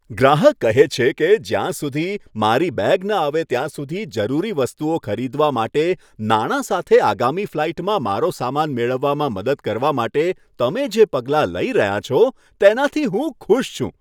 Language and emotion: Gujarati, happy